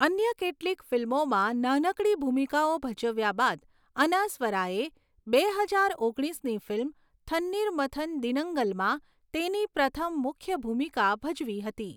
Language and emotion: Gujarati, neutral